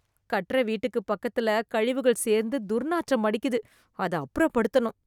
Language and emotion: Tamil, disgusted